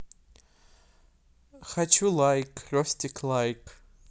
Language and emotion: Russian, neutral